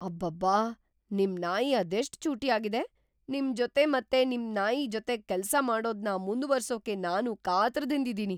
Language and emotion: Kannada, surprised